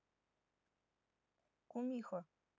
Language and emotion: Russian, neutral